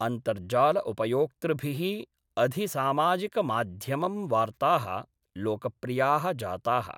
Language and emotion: Sanskrit, neutral